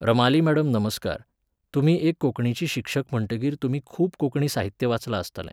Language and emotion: Goan Konkani, neutral